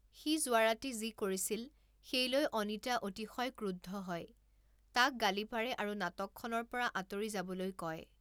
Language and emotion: Assamese, neutral